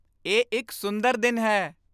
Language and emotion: Punjabi, happy